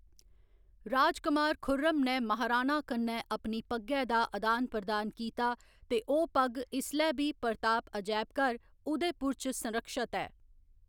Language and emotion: Dogri, neutral